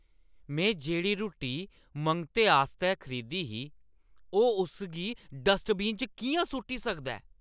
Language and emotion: Dogri, angry